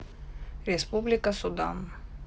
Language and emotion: Russian, neutral